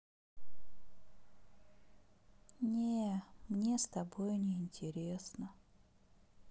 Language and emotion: Russian, sad